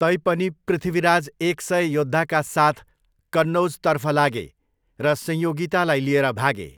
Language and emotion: Nepali, neutral